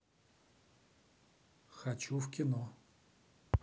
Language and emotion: Russian, neutral